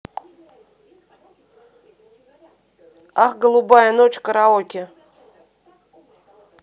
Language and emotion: Russian, neutral